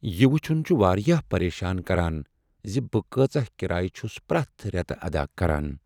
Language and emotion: Kashmiri, sad